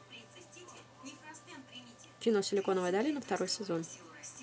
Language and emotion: Russian, neutral